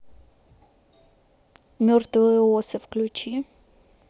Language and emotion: Russian, neutral